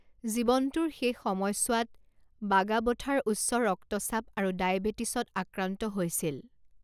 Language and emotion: Assamese, neutral